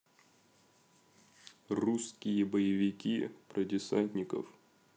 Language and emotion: Russian, neutral